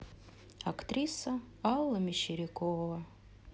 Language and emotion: Russian, sad